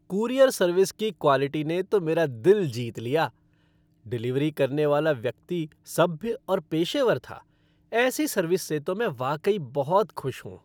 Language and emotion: Hindi, happy